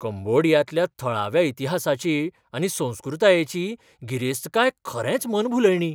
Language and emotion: Goan Konkani, surprised